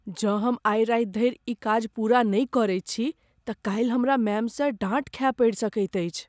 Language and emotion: Maithili, fearful